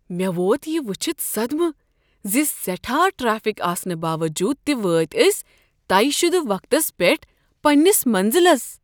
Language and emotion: Kashmiri, surprised